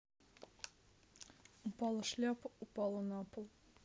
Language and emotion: Russian, neutral